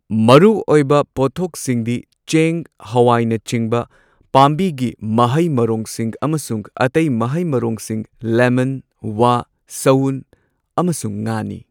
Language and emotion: Manipuri, neutral